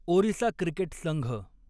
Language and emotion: Marathi, neutral